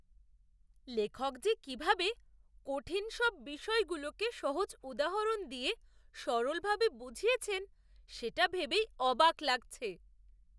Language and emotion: Bengali, surprised